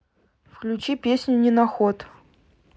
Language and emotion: Russian, neutral